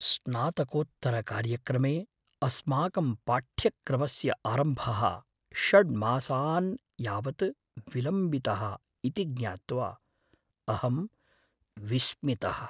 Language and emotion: Sanskrit, fearful